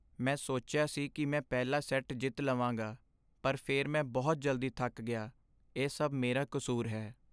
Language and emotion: Punjabi, sad